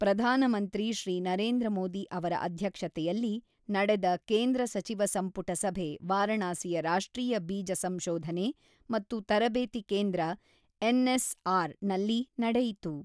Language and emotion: Kannada, neutral